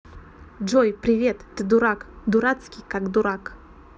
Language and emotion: Russian, neutral